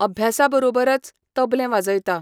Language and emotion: Goan Konkani, neutral